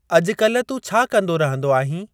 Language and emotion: Sindhi, neutral